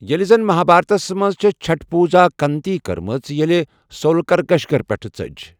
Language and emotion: Kashmiri, neutral